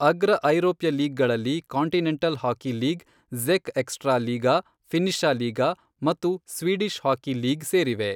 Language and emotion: Kannada, neutral